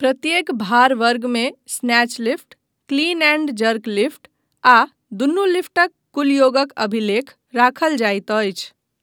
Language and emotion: Maithili, neutral